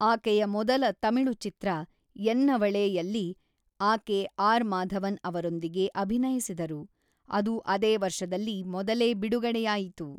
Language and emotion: Kannada, neutral